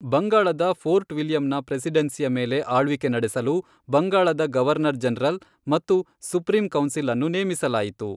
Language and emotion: Kannada, neutral